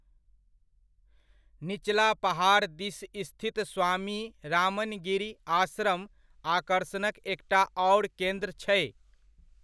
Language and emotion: Maithili, neutral